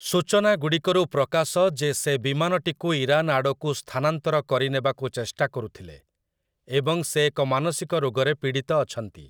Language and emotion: Odia, neutral